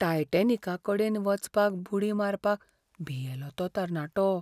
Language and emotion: Goan Konkani, fearful